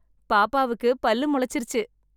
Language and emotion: Tamil, happy